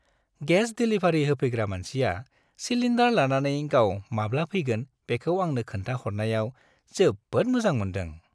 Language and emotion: Bodo, happy